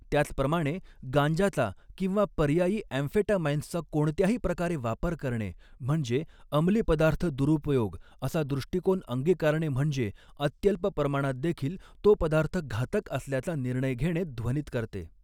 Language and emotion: Marathi, neutral